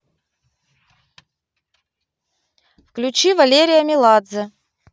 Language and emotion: Russian, neutral